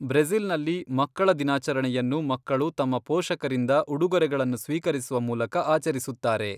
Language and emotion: Kannada, neutral